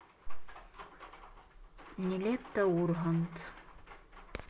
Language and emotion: Russian, neutral